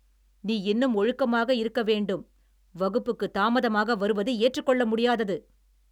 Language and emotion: Tamil, angry